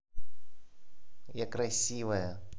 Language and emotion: Russian, positive